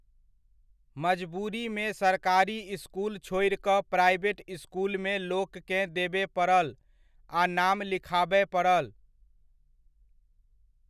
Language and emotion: Maithili, neutral